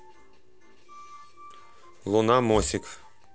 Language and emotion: Russian, neutral